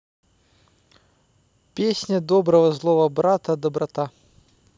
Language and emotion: Russian, neutral